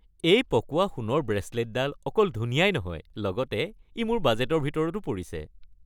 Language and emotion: Assamese, happy